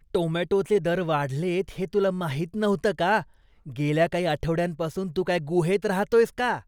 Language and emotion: Marathi, disgusted